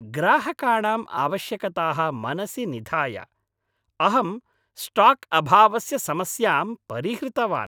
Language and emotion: Sanskrit, happy